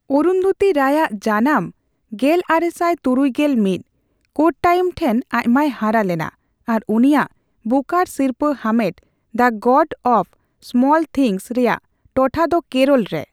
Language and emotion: Santali, neutral